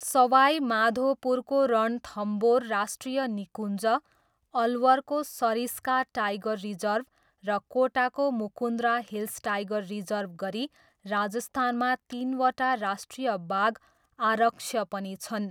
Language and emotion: Nepali, neutral